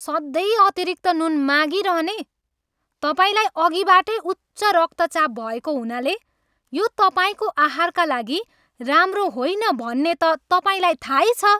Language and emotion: Nepali, angry